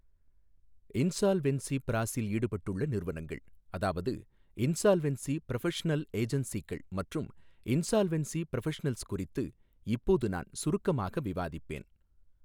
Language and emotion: Tamil, neutral